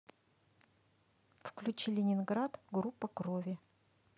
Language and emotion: Russian, neutral